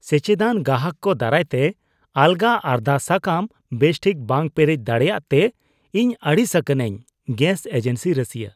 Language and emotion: Santali, disgusted